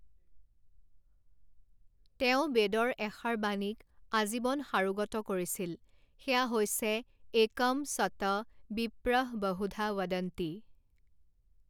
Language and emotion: Assamese, neutral